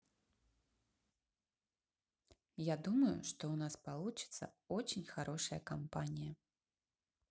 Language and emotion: Russian, neutral